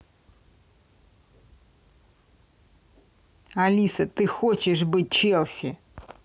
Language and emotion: Russian, angry